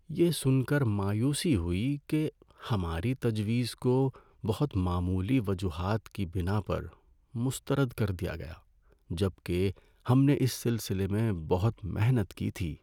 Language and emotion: Urdu, sad